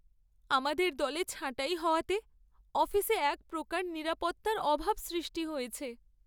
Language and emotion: Bengali, sad